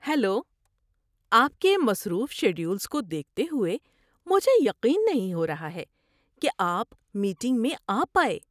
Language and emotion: Urdu, surprised